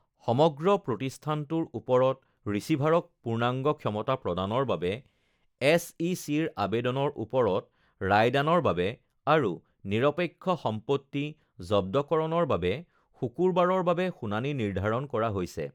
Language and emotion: Assamese, neutral